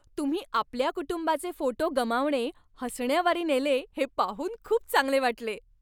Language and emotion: Marathi, happy